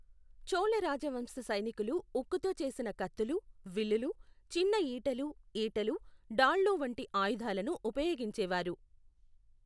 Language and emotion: Telugu, neutral